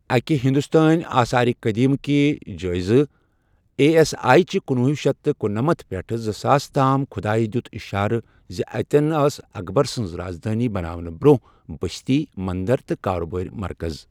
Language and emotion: Kashmiri, neutral